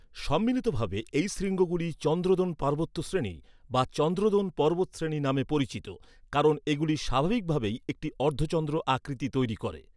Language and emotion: Bengali, neutral